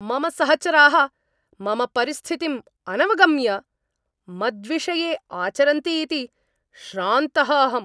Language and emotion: Sanskrit, angry